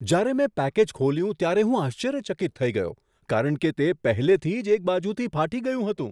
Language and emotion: Gujarati, surprised